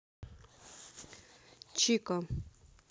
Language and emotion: Russian, neutral